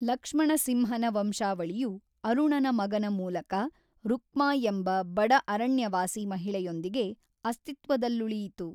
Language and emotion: Kannada, neutral